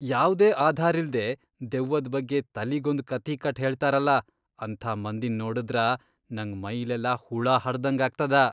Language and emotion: Kannada, disgusted